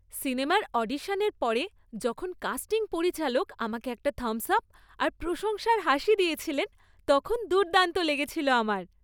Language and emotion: Bengali, happy